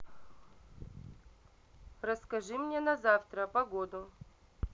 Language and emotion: Russian, neutral